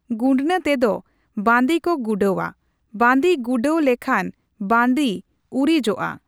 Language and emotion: Santali, neutral